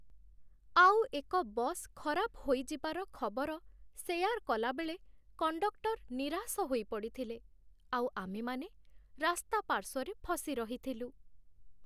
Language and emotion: Odia, sad